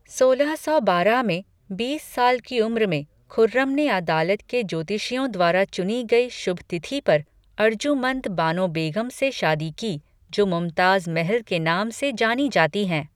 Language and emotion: Hindi, neutral